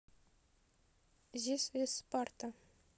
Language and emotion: Russian, neutral